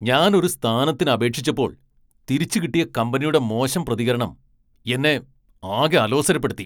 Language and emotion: Malayalam, angry